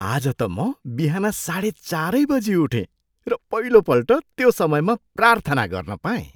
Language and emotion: Nepali, surprised